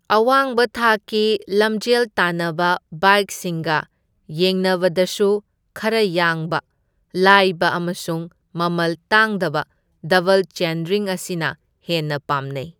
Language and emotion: Manipuri, neutral